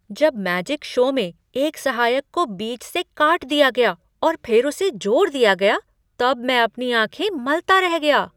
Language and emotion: Hindi, surprised